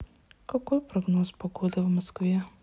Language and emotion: Russian, sad